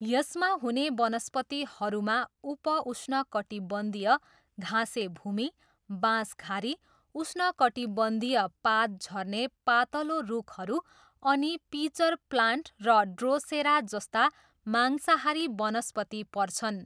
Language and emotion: Nepali, neutral